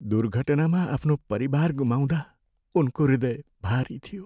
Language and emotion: Nepali, sad